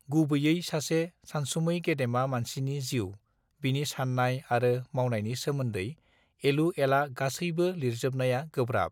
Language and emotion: Bodo, neutral